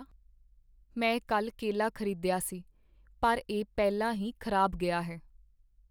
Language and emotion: Punjabi, sad